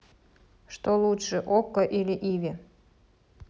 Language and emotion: Russian, neutral